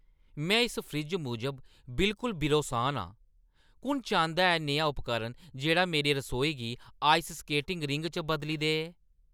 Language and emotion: Dogri, angry